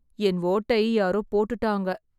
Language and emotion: Tamil, sad